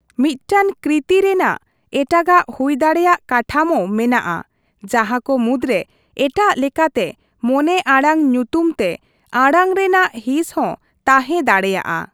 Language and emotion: Santali, neutral